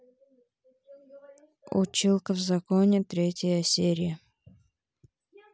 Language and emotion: Russian, neutral